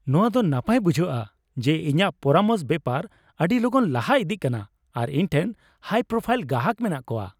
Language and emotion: Santali, happy